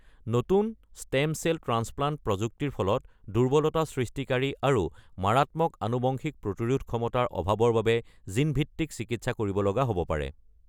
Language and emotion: Assamese, neutral